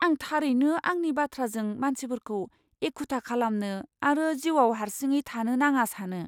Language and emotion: Bodo, fearful